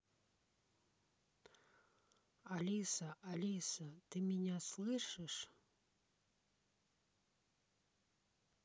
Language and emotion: Russian, neutral